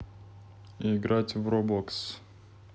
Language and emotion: Russian, neutral